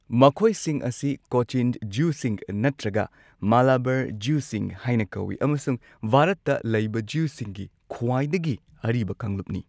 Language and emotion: Manipuri, neutral